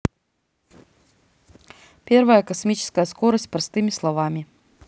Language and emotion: Russian, neutral